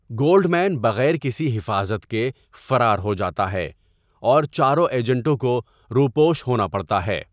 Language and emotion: Urdu, neutral